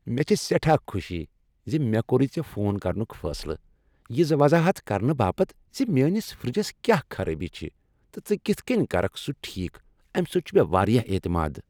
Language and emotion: Kashmiri, happy